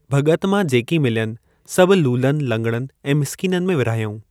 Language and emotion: Sindhi, neutral